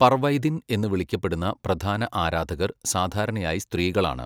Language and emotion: Malayalam, neutral